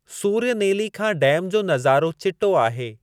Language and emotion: Sindhi, neutral